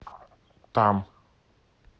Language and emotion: Russian, neutral